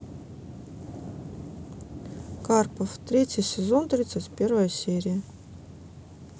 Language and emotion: Russian, neutral